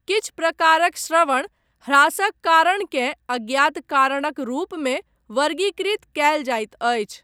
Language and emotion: Maithili, neutral